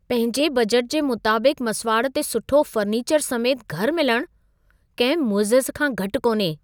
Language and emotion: Sindhi, surprised